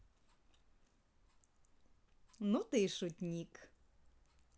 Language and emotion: Russian, positive